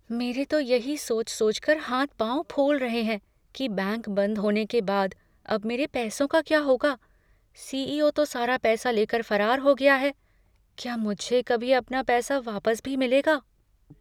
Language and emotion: Hindi, fearful